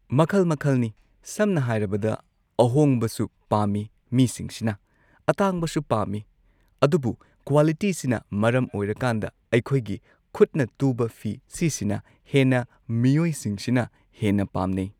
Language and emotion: Manipuri, neutral